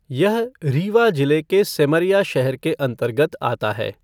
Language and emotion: Hindi, neutral